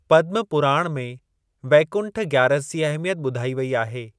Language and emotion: Sindhi, neutral